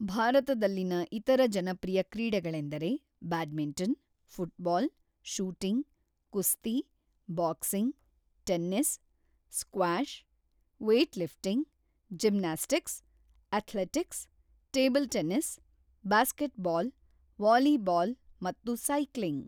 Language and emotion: Kannada, neutral